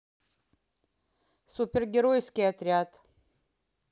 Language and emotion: Russian, neutral